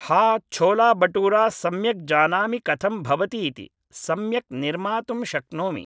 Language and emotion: Sanskrit, neutral